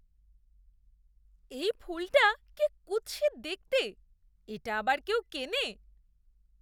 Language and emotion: Bengali, disgusted